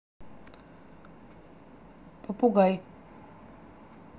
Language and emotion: Russian, neutral